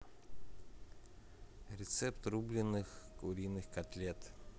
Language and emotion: Russian, neutral